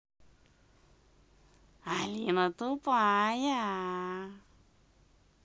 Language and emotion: Russian, positive